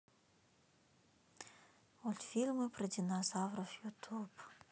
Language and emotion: Russian, sad